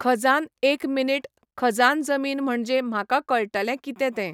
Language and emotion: Goan Konkani, neutral